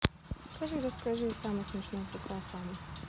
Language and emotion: Russian, neutral